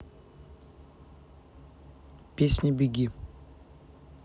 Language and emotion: Russian, neutral